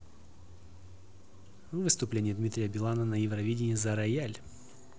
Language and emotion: Russian, neutral